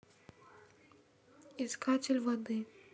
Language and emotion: Russian, neutral